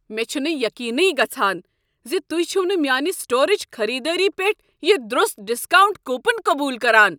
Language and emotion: Kashmiri, angry